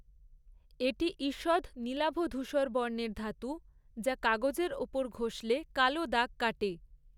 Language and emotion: Bengali, neutral